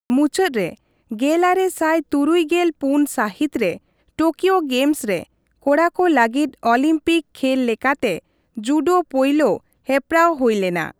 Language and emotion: Santali, neutral